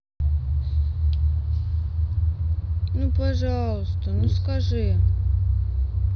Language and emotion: Russian, sad